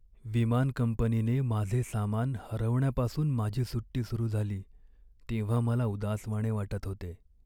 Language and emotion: Marathi, sad